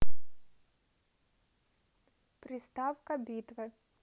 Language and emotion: Russian, neutral